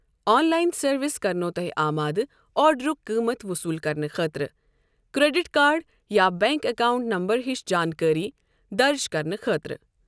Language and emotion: Kashmiri, neutral